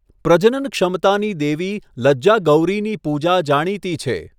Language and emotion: Gujarati, neutral